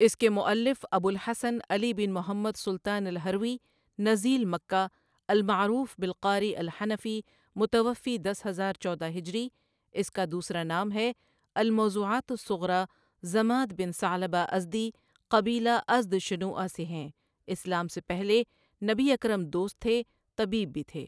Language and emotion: Urdu, neutral